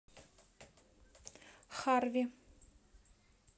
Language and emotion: Russian, neutral